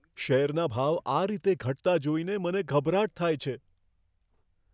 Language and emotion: Gujarati, fearful